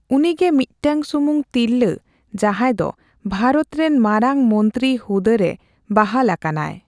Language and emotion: Santali, neutral